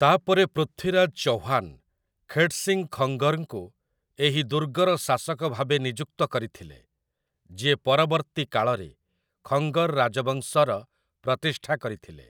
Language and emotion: Odia, neutral